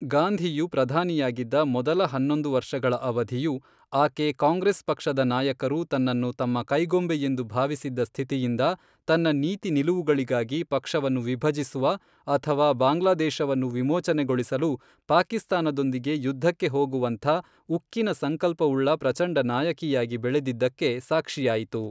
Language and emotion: Kannada, neutral